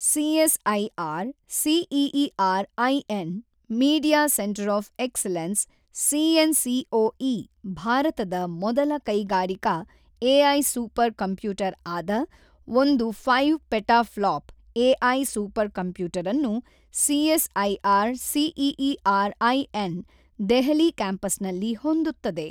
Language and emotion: Kannada, neutral